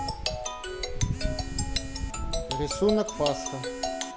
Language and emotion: Russian, neutral